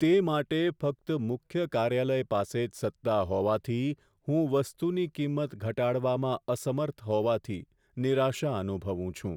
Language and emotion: Gujarati, sad